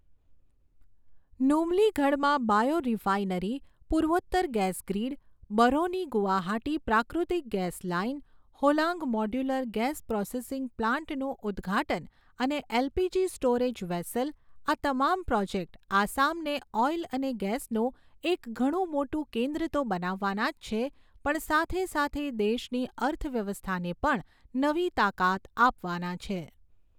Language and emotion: Gujarati, neutral